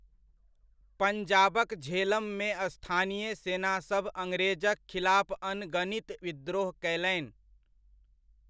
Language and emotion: Maithili, neutral